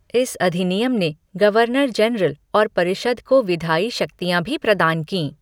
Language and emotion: Hindi, neutral